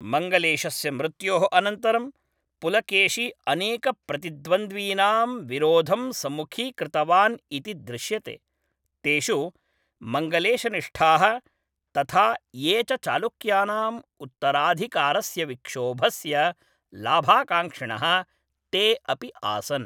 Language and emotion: Sanskrit, neutral